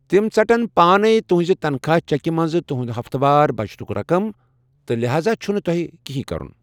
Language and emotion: Kashmiri, neutral